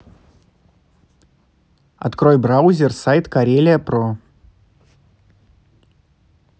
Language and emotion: Russian, neutral